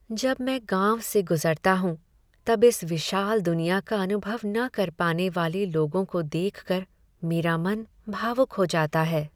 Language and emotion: Hindi, sad